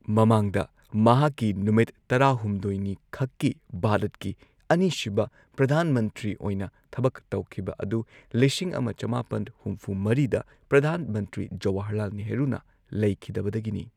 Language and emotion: Manipuri, neutral